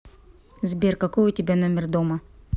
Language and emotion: Russian, neutral